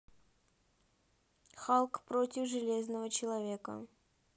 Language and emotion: Russian, neutral